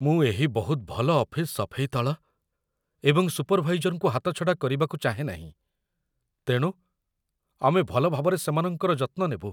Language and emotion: Odia, fearful